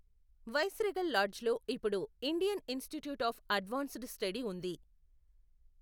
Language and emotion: Telugu, neutral